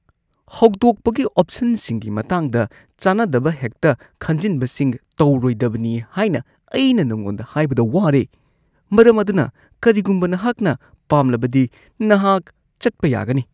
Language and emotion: Manipuri, disgusted